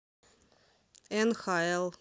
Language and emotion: Russian, neutral